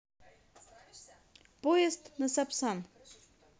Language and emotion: Russian, positive